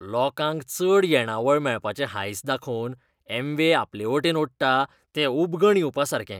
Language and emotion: Goan Konkani, disgusted